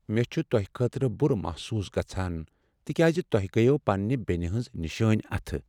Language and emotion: Kashmiri, sad